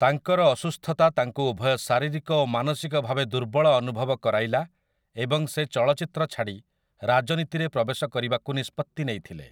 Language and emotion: Odia, neutral